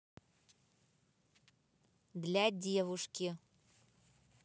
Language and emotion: Russian, neutral